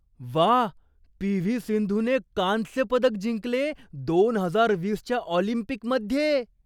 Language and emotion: Marathi, surprised